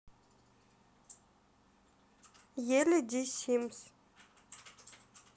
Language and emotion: Russian, neutral